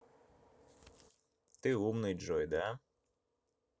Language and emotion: Russian, neutral